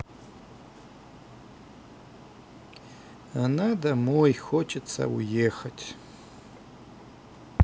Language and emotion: Russian, sad